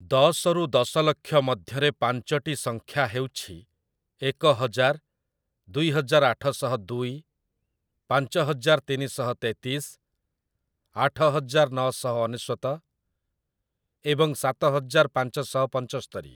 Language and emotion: Odia, neutral